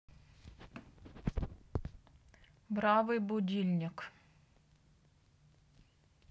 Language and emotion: Russian, neutral